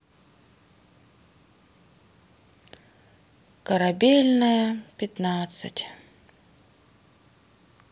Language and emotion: Russian, sad